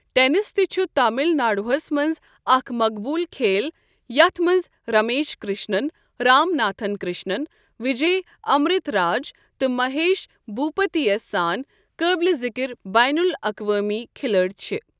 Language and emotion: Kashmiri, neutral